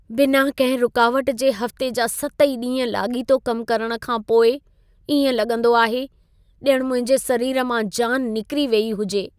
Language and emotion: Sindhi, sad